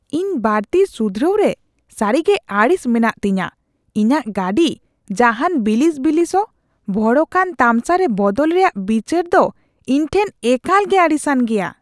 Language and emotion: Santali, disgusted